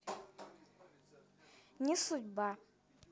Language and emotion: Russian, neutral